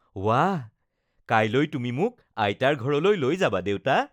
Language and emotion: Assamese, happy